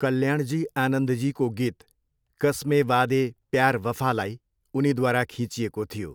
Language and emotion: Nepali, neutral